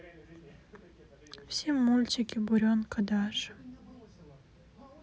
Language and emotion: Russian, sad